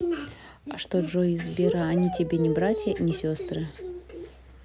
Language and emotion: Russian, neutral